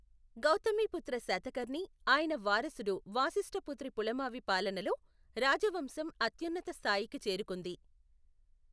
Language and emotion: Telugu, neutral